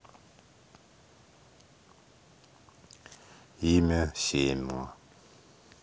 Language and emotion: Russian, neutral